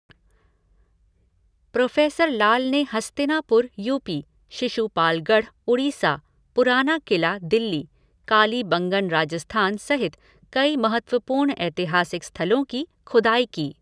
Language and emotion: Hindi, neutral